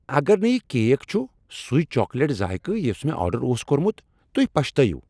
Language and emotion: Kashmiri, angry